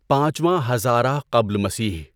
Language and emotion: Urdu, neutral